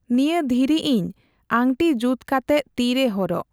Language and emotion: Santali, neutral